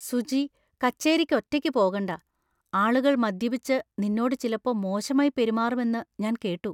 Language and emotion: Malayalam, fearful